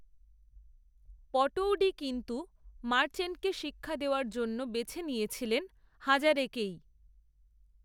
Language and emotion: Bengali, neutral